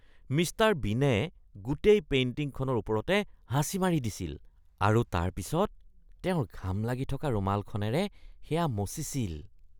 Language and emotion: Assamese, disgusted